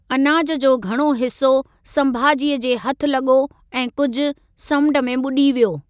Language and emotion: Sindhi, neutral